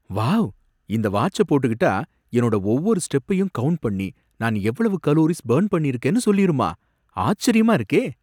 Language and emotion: Tamil, surprised